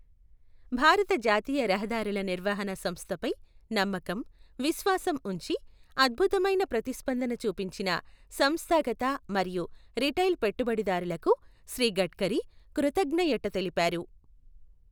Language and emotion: Telugu, neutral